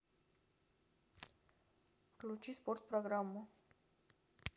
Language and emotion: Russian, neutral